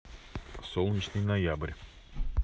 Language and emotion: Russian, neutral